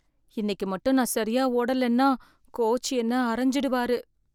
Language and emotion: Tamil, fearful